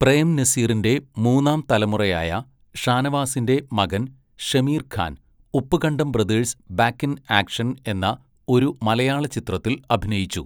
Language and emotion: Malayalam, neutral